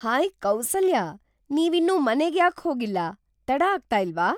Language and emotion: Kannada, surprised